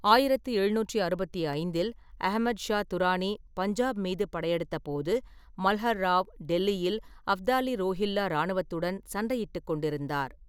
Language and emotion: Tamil, neutral